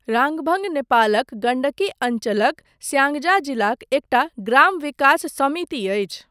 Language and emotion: Maithili, neutral